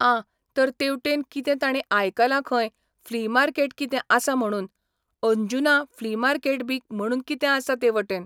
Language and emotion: Goan Konkani, neutral